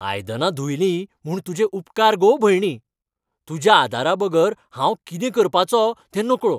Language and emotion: Goan Konkani, happy